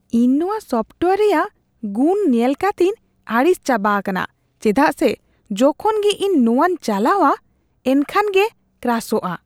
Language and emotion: Santali, disgusted